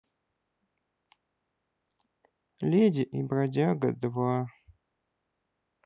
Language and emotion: Russian, sad